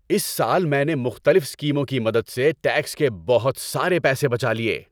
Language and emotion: Urdu, happy